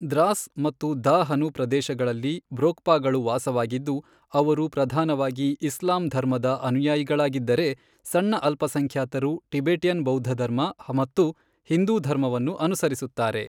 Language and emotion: Kannada, neutral